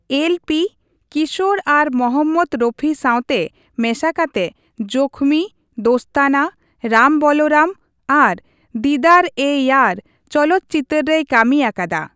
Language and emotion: Santali, neutral